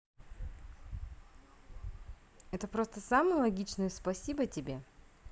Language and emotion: Russian, positive